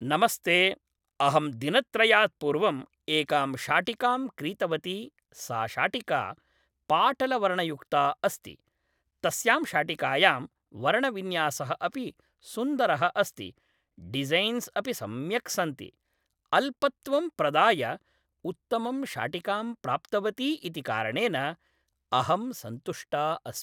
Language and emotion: Sanskrit, neutral